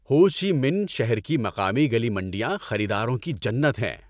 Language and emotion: Urdu, happy